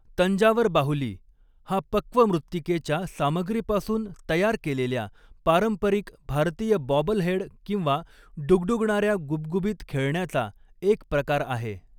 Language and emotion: Marathi, neutral